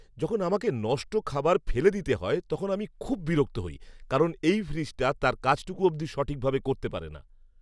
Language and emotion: Bengali, angry